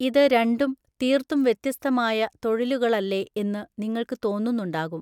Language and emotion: Malayalam, neutral